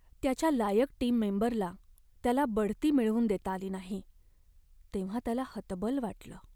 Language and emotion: Marathi, sad